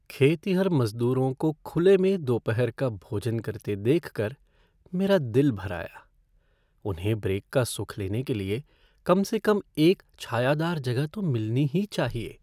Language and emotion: Hindi, sad